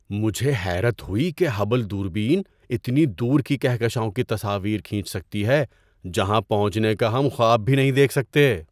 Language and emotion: Urdu, surprised